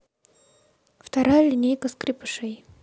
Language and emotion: Russian, neutral